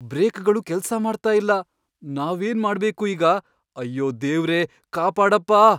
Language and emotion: Kannada, fearful